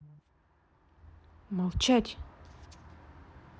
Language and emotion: Russian, angry